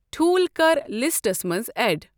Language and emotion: Kashmiri, neutral